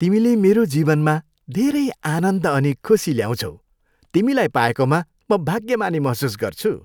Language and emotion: Nepali, happy